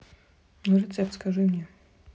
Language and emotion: Russian, neutral